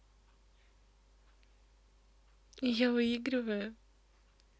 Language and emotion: Russian, positive